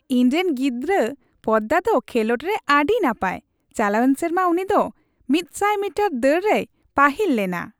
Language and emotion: Santali, happy